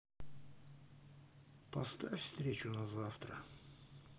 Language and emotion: Russian, neutral